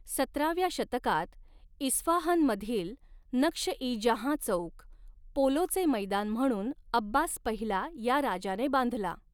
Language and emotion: Marathi, neutral